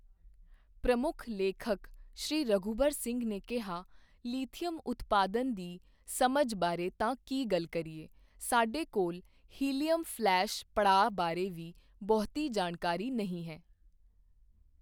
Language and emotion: Punjabi, neutral